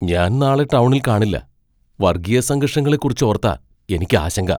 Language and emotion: Malayalam, fearful